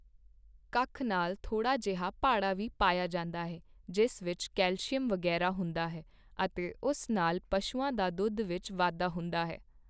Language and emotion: Punjabi, neutral